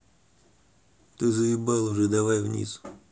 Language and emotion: Russian, angry